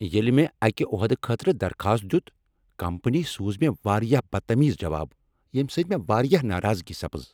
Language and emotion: Kashmiri, angry